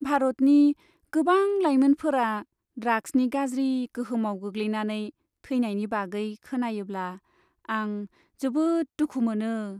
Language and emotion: Bodo, sad